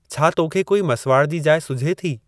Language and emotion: Sindhi, neutral